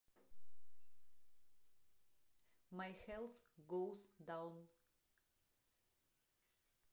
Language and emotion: Russian, neutral